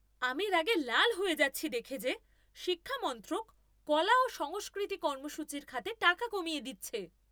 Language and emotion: Bengali, angry